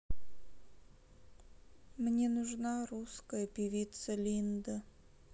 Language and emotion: Russian, sad